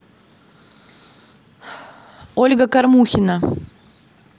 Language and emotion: Russian, neutral